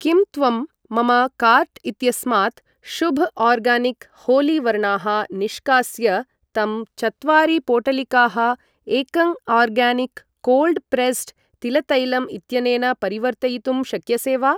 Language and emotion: Sanskrit, neutral